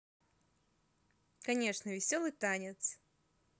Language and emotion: Russian, positive